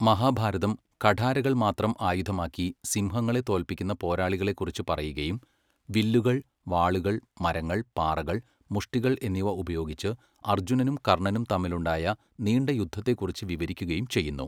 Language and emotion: Malayalam, neutral